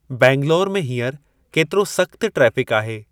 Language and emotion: Sindhi, neutral